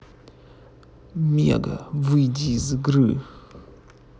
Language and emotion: Russian, angry